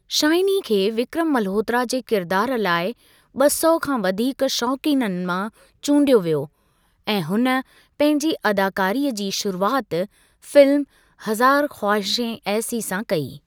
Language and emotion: Sindhi, neutral